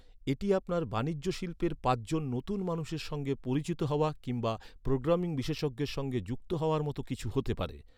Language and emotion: Bengali, neutral